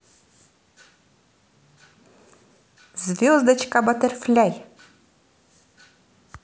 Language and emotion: Russian, positive